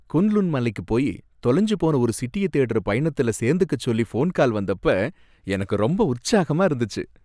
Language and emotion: Tamil, happy